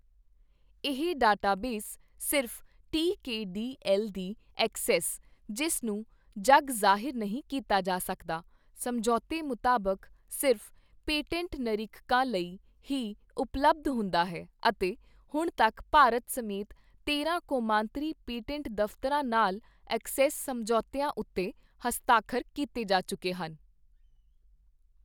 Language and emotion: Punjabi, neutral